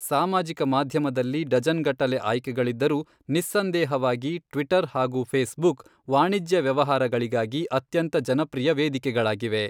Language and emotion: Kannada, neutral